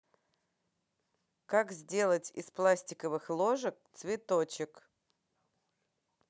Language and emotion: Russian, positive